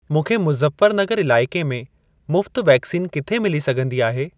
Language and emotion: Sindhi, neutral